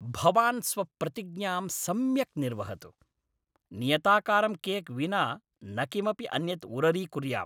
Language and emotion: Sanskrit, angry